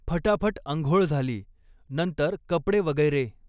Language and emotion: Marathi, neutral